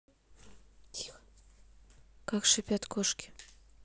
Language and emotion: Russian, neutral